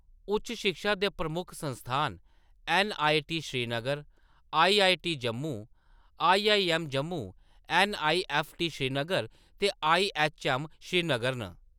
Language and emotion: Dogri, neutral